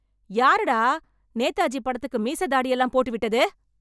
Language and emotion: Tamil, angry